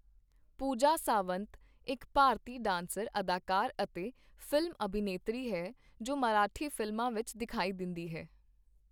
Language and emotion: Punjabi, neutral